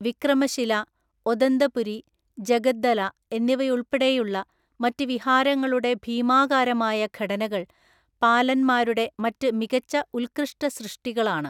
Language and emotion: Malayalam, neutral